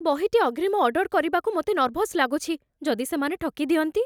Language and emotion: Odia, fearful